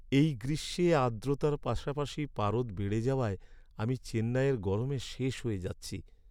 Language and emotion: Bengali, sad